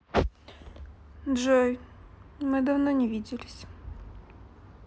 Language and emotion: Russian, sad